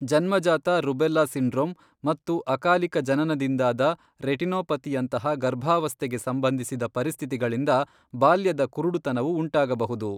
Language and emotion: Kannada, neutral